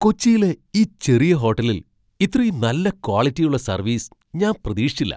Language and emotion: Malayalam, surprised